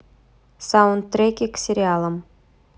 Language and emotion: Russian, neutral